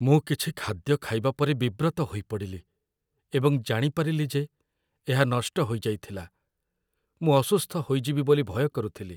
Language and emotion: Odia, fearful